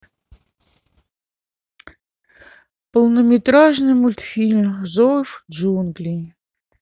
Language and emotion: Russian, sad